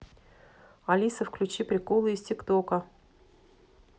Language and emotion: Russian, neutral